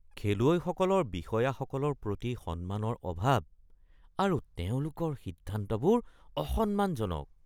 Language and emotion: Assamese, disgusted